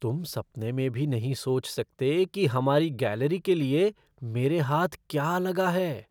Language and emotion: Hindi, surprised